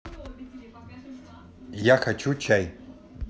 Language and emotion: Russian, neutral